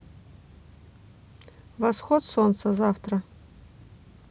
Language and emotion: Russian, neutral